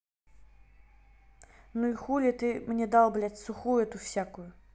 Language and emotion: Russian, angry